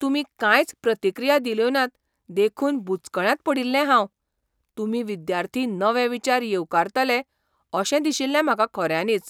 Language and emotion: Goan Konkani, surprised